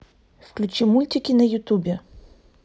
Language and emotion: Russian, neutral